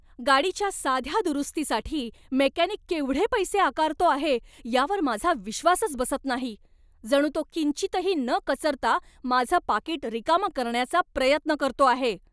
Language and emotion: Marathi, angry